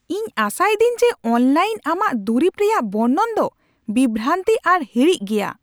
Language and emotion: Santali, angry